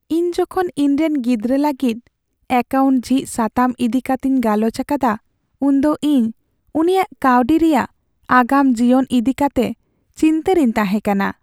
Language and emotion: Santali, sad